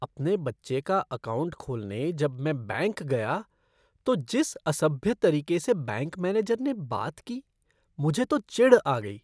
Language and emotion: Hindi, disgusted